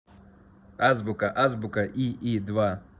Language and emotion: Russian, neutral